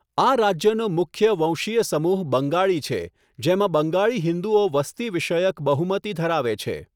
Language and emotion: Gujarati, neutral